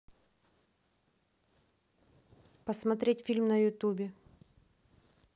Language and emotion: Russian, neutral